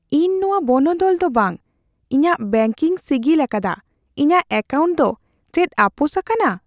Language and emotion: Santali, fearful